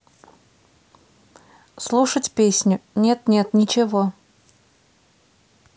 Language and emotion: Russian, neutral